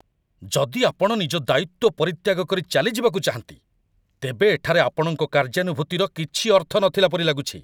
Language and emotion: Odia, angry